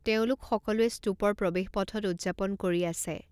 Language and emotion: Assamese, neutral